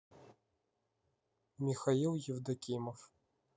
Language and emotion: Russian, neutral